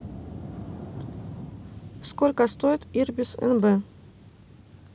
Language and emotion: Russian, neutral